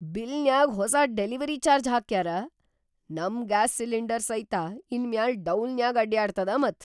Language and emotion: Kannada, surprised